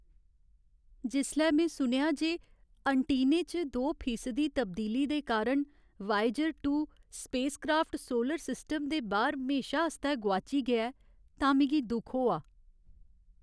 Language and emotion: Dogri, sad